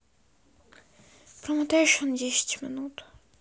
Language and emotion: Russian, sad